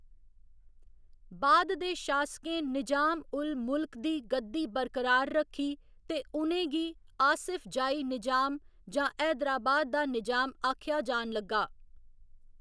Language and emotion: Dogri, neutral